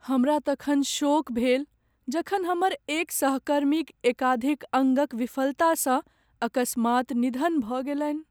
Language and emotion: Maithili, sad